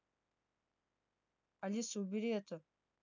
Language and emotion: Russian, neutral